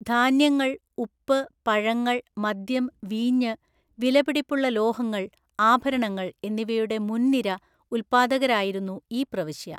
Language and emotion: Malayalam, neutral